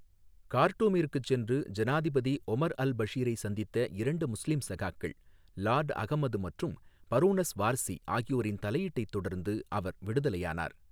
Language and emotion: Tamil, neutral